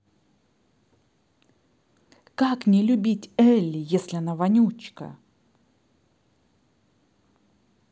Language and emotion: Russian, angry